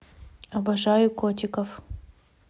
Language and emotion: Russian, neutral